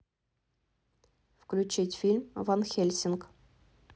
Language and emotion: Russian, neutral